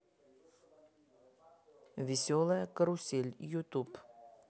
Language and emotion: Russian, neutral